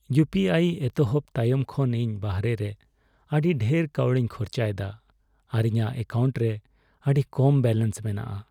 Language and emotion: Santali, sad